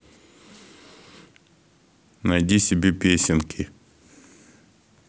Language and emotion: Russian, neutral